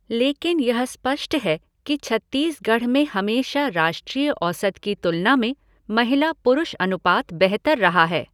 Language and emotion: Hindi, neutral